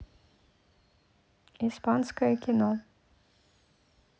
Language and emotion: Russian, neutral